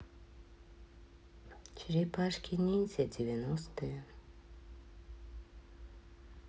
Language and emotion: Russian, neutral